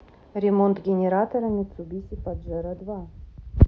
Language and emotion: Russian, neutral